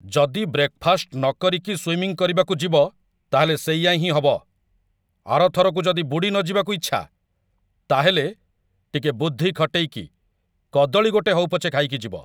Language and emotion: Odia, angry